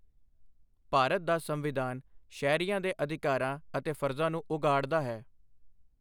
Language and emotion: Punjabi, neutral